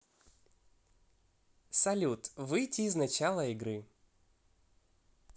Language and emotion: Russian, positive